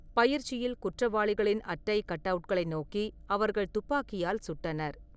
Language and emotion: Tamil, neutral